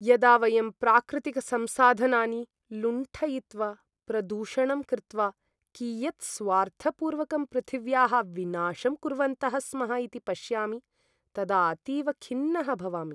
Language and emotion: Sanskrit, sad